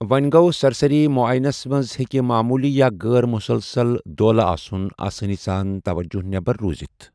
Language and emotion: Kashmiri, neutral